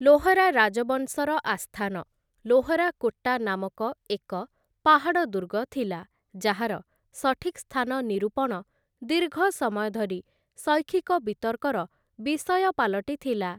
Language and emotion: Odia, neutral